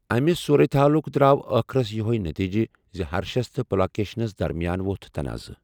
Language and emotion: Kashmiri, neutral